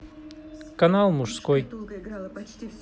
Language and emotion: Russian, neutral